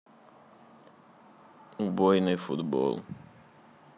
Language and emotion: Russian, sad